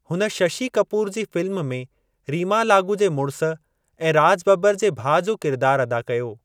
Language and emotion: Sindhi, neutral